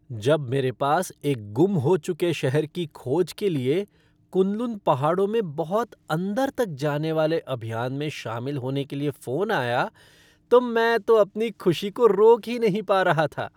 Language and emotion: Hindi, happy